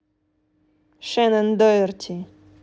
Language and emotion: Russian, neutral